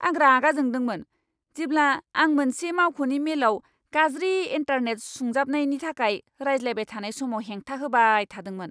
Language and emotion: Bodo, angry